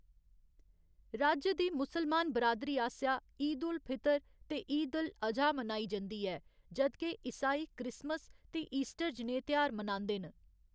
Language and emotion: Dogri, neutral